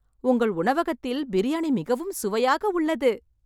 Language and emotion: Tamil, happy